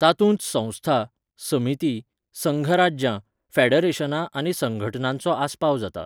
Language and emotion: Goan Konkani, neutral